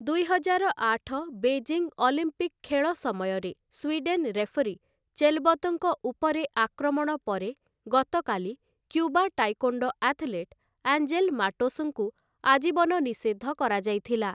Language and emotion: Odia, neutral